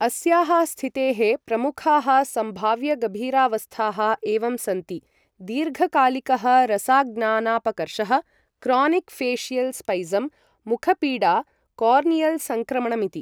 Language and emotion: Sanskrit, neutral